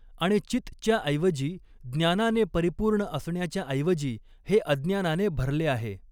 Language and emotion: Marathi, neutral